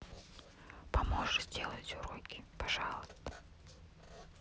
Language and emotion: Russian, neutral